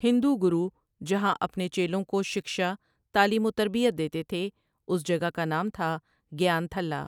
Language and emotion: Urdu, neutral